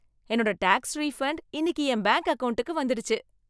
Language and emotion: Tamil, happy